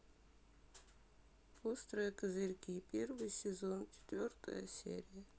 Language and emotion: Russian, sad